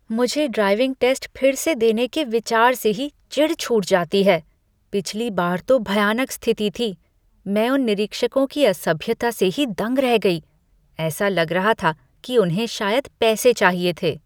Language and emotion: Hindi, disgusted